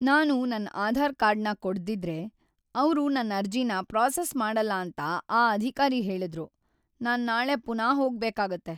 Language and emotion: Kannada, sad